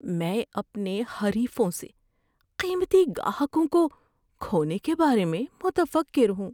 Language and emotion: Urdu, fearful